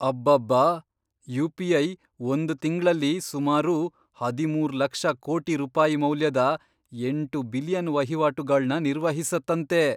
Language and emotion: Kannada, surprised